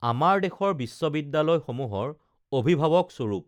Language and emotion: Assamese, neutral